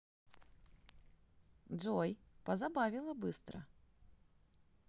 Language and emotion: Russian, positive